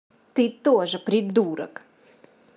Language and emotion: Russian, angry